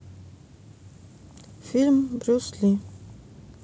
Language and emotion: Russian, neutral